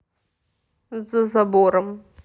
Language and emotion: Russian, neutral